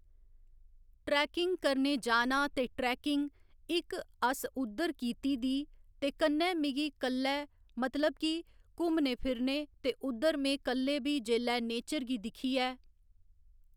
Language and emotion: Dogri, neutral